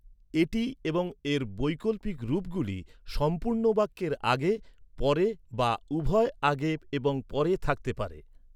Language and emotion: Bengali, neutral